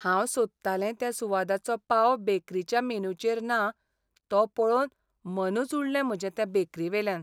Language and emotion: Goan Konkani, sad